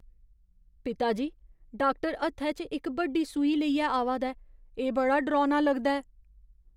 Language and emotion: Dogri, fearful